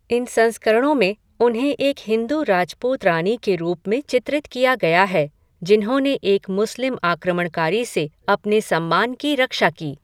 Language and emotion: Hindi, neutral